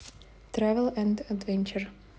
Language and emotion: Russian, neutral